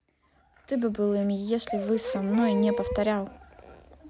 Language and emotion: Russian, angry